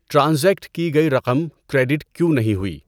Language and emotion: Urdu, neutral